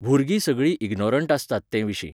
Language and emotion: Goan Konkani, neutral